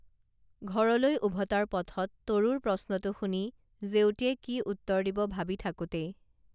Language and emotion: Assamese, neutral